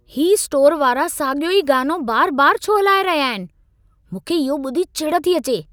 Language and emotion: Sindhi, angry